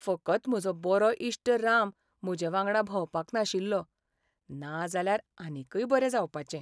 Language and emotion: Goan Konkani, sad